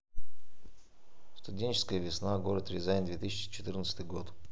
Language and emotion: Russian, neutral